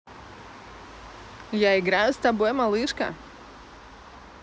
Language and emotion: Russian, positive